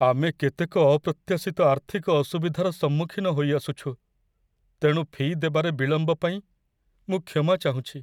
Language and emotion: Odia, sad